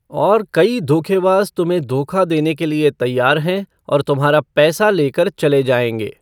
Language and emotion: Hindi, neutral